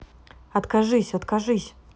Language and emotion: Russian, neutral